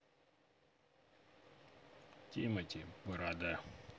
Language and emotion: Russian, neutral